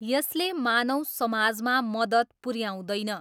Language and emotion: Nepali, neutral